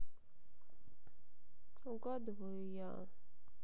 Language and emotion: Russian, sad